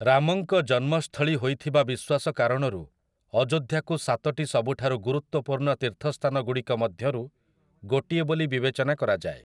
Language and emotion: Odia, neutral